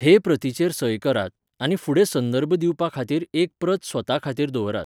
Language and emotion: Goan Konkani, neutral